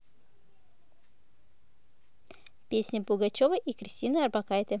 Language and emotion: Russian, neutral